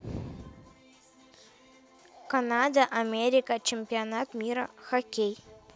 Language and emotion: Russian, neutral